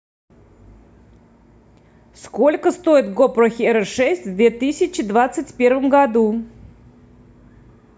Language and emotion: Russian, neutral